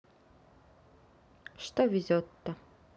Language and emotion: Russian, neutral